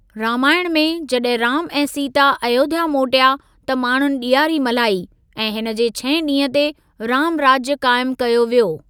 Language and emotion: Sindhi, neutral